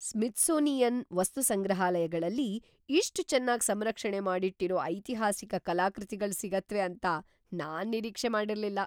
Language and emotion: Kannada, surprised